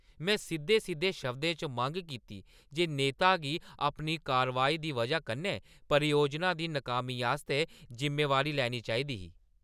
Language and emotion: Dogri, angry